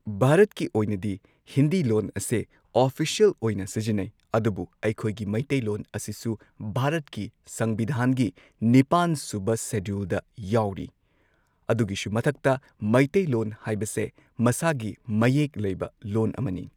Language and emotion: Manipuri, neutral